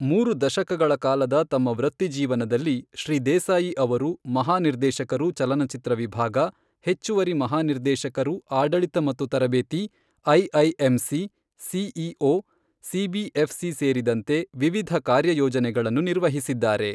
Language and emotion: Kannada, neutral